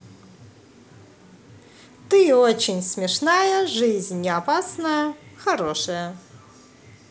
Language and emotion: Russian, positive